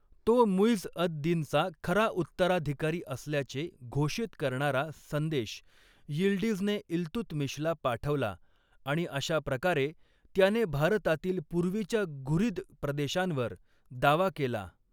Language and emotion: Marathi, neutral